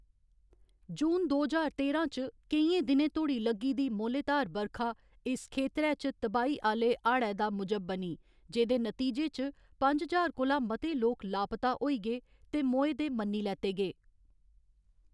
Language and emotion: Dogri, neutral